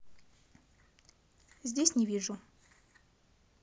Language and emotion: Russian, neutral